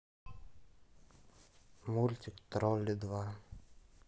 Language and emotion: Russian, neutral